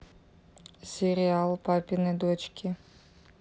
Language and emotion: Russian, neutral